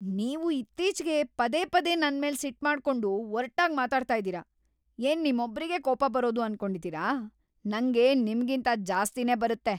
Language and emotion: Kannada, angry